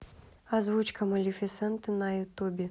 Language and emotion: Russian, neutral